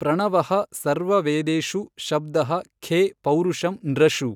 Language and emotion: Kannada, neutral